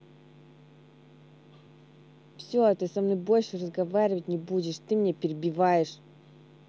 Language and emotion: Russian, angry